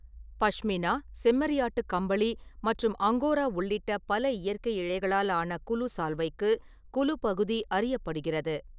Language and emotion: Tamil, neutral